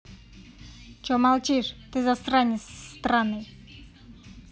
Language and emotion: Russian, angry